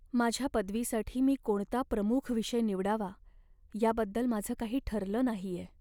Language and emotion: Marathi, sad